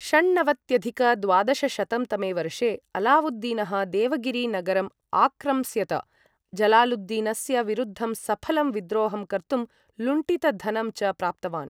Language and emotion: Sanskrit, neutral